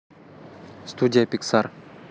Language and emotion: Russian, neutral